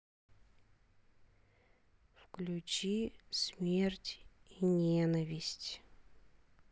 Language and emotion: Russian, neutral